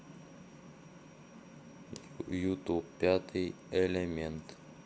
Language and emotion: Russian, neutral